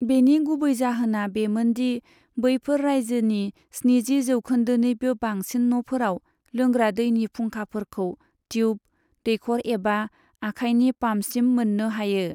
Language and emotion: Bodo, neutral